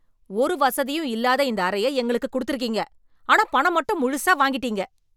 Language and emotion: Tamil, angry